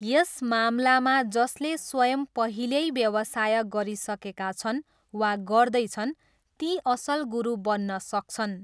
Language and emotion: Nepali, neutral